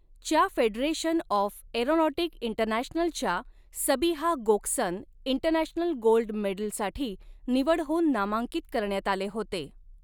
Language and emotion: Marathi, neutral